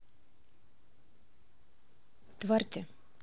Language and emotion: Russian, neutral